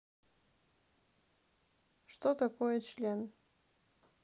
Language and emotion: Russian, neutral